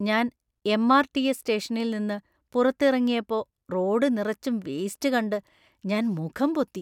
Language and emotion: Malayalam, disgusted